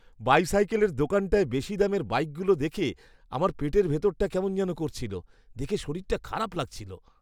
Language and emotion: Bengali, disgusted